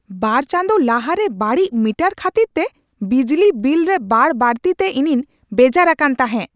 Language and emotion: Santali, angry